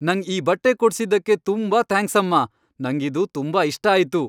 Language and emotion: Kannada, happy